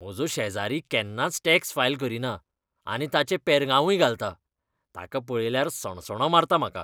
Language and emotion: Goan Konkani, disgusted